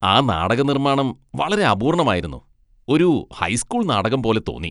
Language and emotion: Malayalam, disgusted